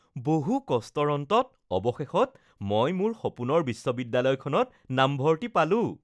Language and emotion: Assamese, happy